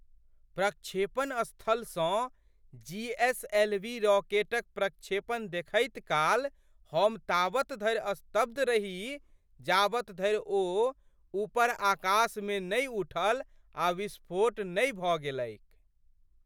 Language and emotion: Maithili, surprised